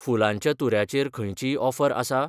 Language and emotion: Goan Konkani, neutral